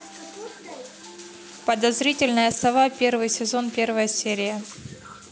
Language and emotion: Russian, neutral